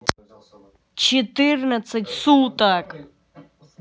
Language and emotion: Russian, angry